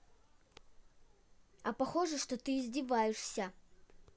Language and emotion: Russian, angry